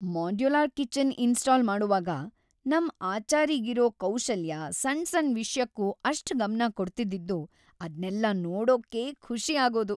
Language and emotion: Kannada, happy